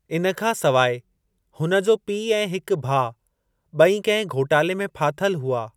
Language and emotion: Sindhi, neutral